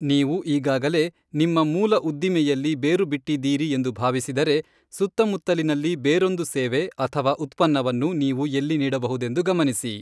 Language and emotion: Kannada, neutral